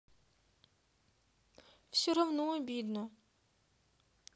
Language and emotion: Russian, sad